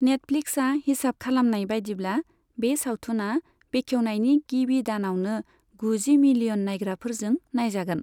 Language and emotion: Bodo, neutral